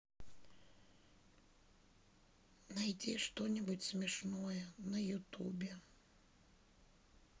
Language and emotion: Russian, sad